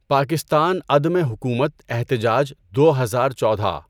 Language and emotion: Urdu, neutral